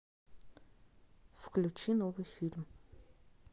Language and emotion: Russian, neutral